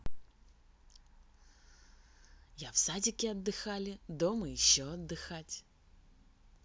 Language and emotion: Russian, positive